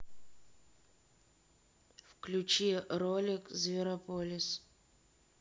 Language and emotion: Russian, neutral